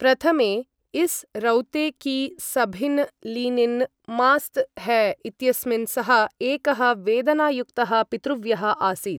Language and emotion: Sanskrit, neutral